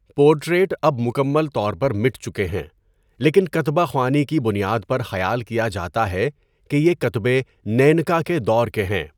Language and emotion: Urdu, neutral